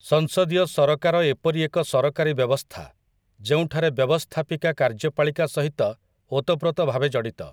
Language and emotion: Odia, neutral